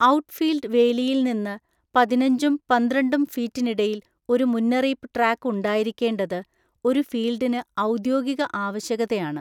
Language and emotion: Malayalam, neutral